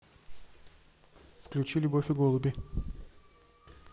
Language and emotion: Russian, neutral